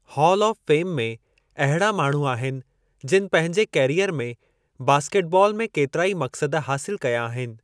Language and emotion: Sindhi, neutral